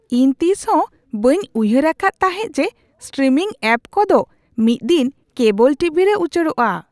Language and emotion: Santali, surprised